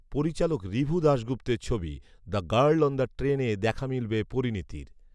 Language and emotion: Bengali, neutral